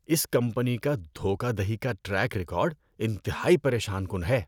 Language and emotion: Urdu, disgusted